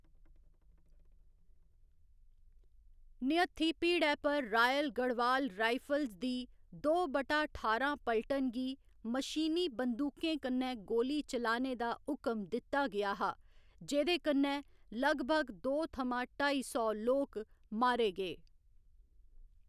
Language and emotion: Dogri, neutral